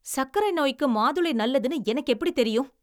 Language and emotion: Tamil, angry